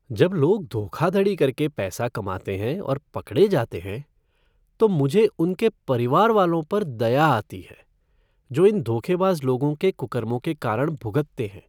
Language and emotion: Hindi, sad